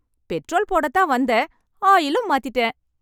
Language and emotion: Tamil, happy